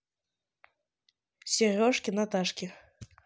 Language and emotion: Russian, neutral